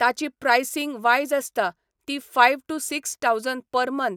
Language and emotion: Goan Konkani, neutral